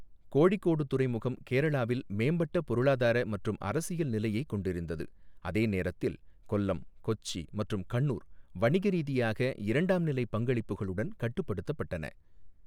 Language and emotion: Tamil, neutral